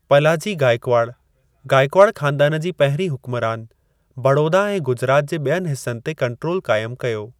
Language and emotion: Sindhi, neutral